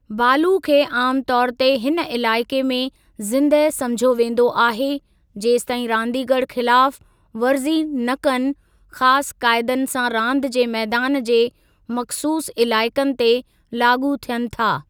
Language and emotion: Sindhi, neutral